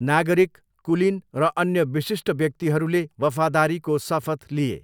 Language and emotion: Nepali, neutral